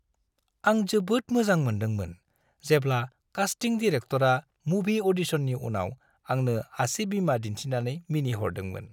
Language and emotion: Bodo, happy